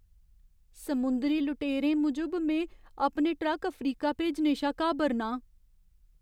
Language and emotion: Dogri, fearful